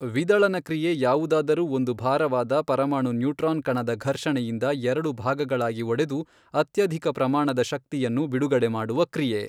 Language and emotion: Kannada, neutral